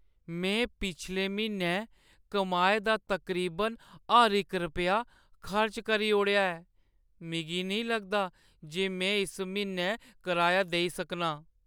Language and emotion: Dogri, sad